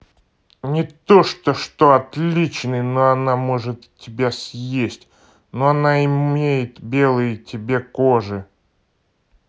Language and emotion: Russian, angry